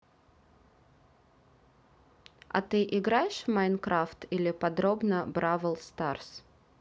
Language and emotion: Russian, neutral